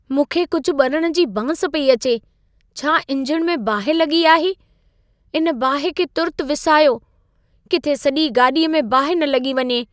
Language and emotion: Sindhi, fearful